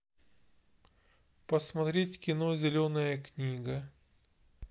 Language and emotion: Russian, neutral